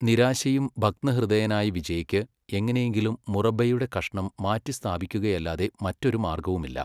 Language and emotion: Malayalam, neutral